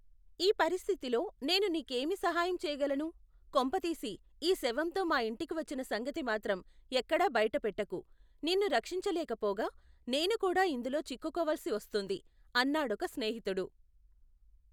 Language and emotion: Telugu, neutral